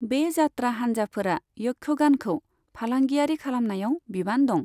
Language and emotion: Bodo, neutral